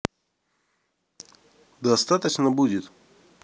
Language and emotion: Russian, neutral